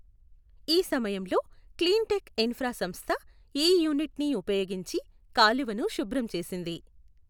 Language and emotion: Telugu, neutral